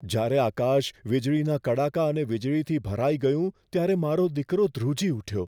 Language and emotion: Gujarati, fearful